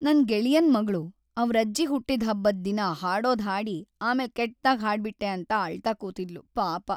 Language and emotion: Kannada, sad